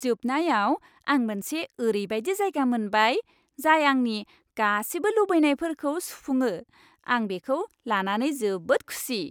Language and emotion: Bodo, happy